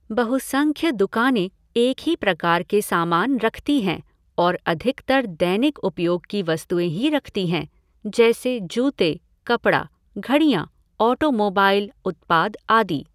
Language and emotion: Hindi, neutral